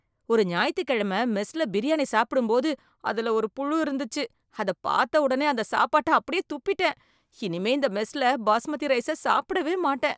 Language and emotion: Tamil, disgusted